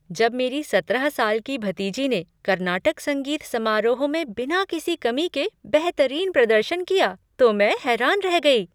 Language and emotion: Hindi, surprised